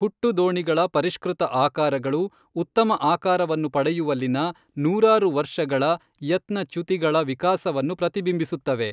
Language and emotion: Kannada, neutral